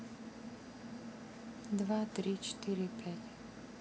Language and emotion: Russian, neutral